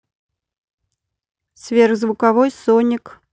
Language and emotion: Russian, neutral